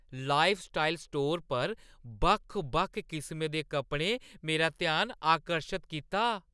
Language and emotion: Dogri, surprised